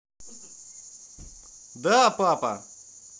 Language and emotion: Russian, positive